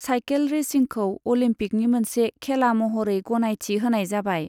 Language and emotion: Bodo, neutral